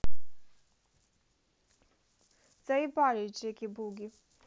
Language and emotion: Russian, angry